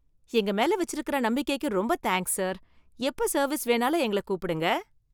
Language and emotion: Tamil, happy